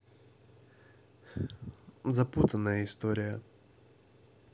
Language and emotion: Russian, neutral